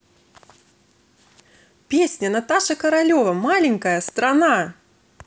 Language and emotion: Russian, positive